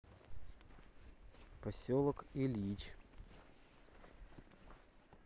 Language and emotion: Russian, neutral